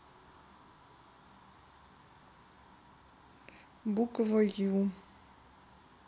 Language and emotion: Russian, neutral